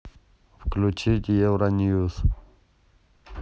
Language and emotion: Russian, neutral